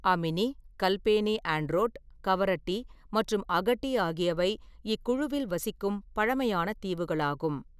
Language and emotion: Tamil, neutral